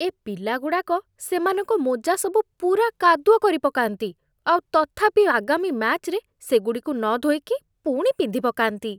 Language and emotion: Odia, disgusted